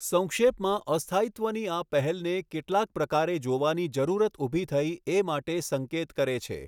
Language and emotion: Gujarati, neutral